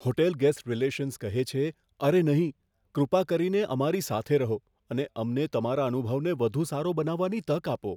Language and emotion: Gujarati, fearful